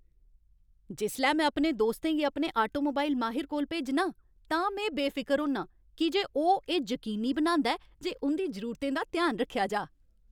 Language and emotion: Dogri, happy